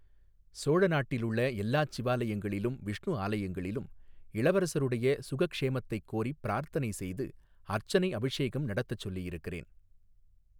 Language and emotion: Tamil, neutral